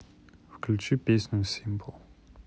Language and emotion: Russian, neutral